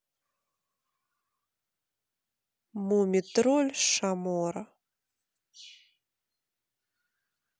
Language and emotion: Russian, neutral